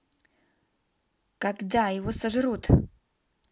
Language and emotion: Russian, neutral